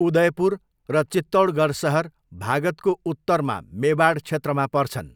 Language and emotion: Nepali, neutral